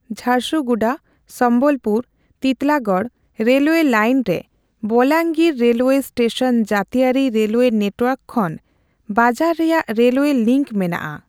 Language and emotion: Santali, neutral